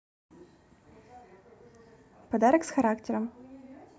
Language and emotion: Russian, positive